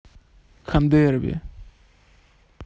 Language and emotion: Russian, neutral